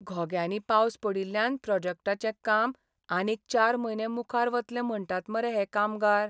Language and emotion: Goan Konkani, sad